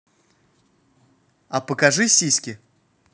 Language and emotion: Russian, positive